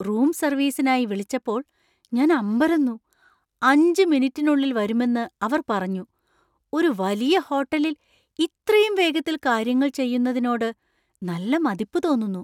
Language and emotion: Malayalam, surprised